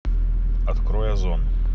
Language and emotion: Russian, neutral